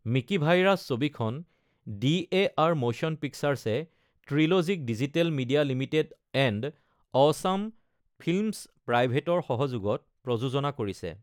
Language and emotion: Assamese, neutral